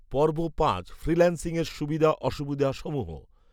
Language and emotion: Bengali, neutral